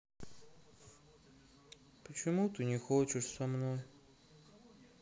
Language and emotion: Russian, sad